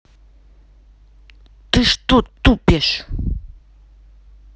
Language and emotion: Russian, angry